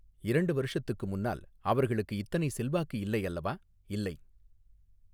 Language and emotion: Tamil, neutral